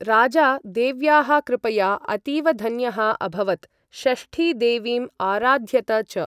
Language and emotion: Sanskrit, neutral